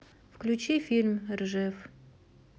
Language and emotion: Russian, neutral